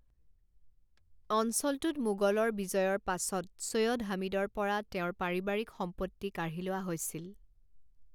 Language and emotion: Assamese, neutral